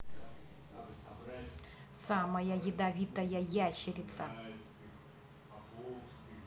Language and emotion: Russian, neutral